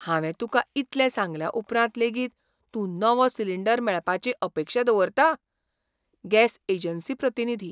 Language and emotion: Goan Konkani, surprised